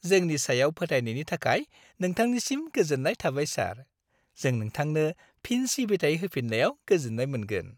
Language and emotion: Bodo, happy